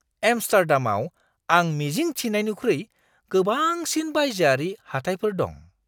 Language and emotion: Bodo, surprised